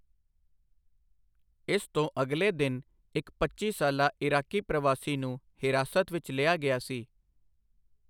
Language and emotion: Punjabi, neutral